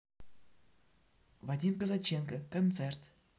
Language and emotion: Russian, neutral